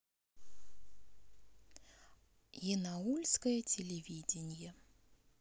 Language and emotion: Russian, neutral